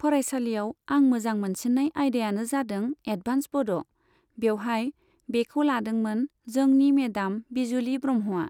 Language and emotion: Bodo, neutral